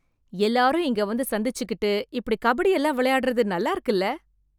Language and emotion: Tamil, happy